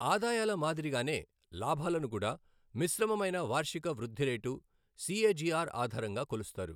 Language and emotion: Telugu, neutral